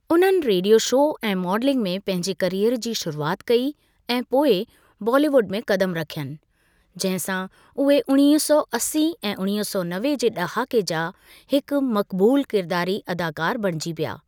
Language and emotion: Sindhi, neutral